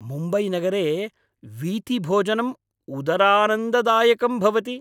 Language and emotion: Sanskrit, happy